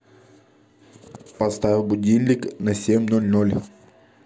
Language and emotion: Russian, neutral